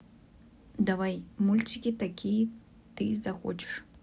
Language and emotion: Russian, neutral